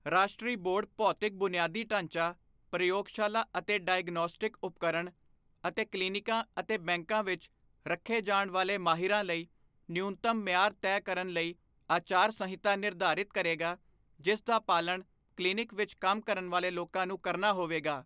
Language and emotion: Punjabi, neutral